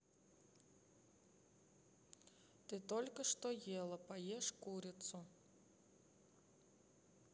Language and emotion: Russian, neutral